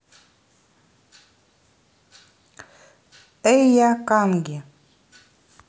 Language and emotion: Russian, neutral